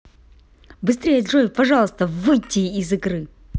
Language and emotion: Russian, angry